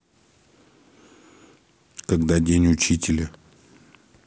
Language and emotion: Russian, neutral